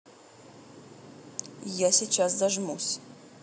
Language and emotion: Russian, neutral